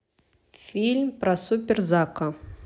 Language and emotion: Russian, neutral